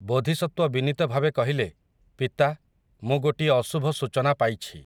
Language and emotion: Odia, neutral